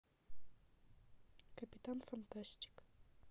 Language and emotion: Russian, neutral